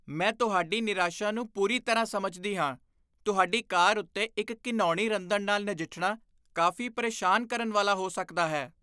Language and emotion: Punjabi, disgusted